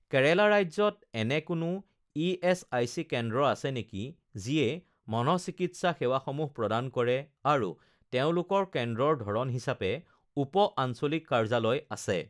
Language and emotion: Assamese, neutral